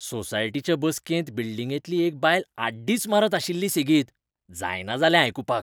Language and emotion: Goan Konkani, disgusted